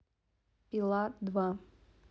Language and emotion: Russian, neutral